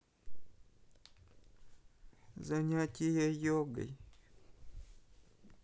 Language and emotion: Russian, sad